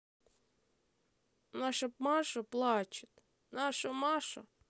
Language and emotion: Russian, sad